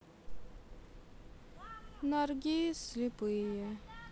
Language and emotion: Russian, sad